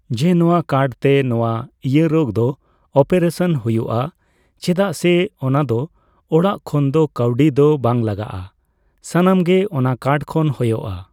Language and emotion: Santali, neutral